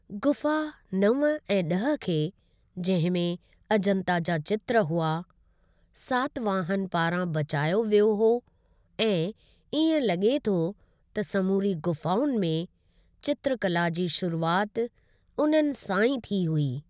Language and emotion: Sindhi, neutral